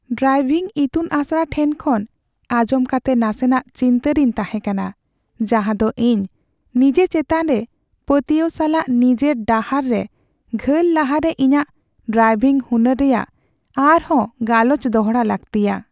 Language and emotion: Santali, sad